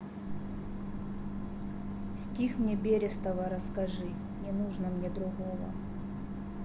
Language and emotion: Russian, sad